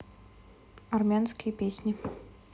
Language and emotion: Russian, neutral